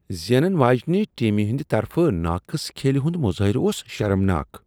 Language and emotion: Kashmiri, disgusted